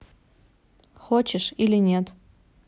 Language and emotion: Russian, neutral